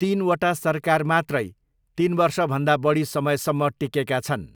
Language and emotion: Nepali, neutral